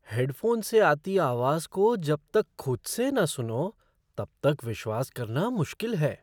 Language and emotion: Hindi, surprised